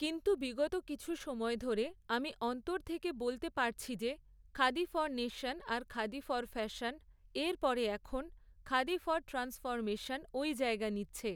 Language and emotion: Bengali, neutral